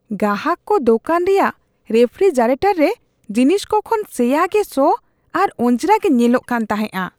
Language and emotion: Santali, disgusted